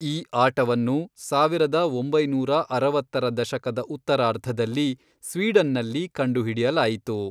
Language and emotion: Kannada, neutral